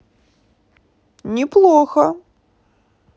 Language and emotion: Russian, positive